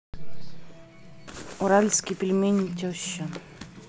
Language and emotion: Russian, neutral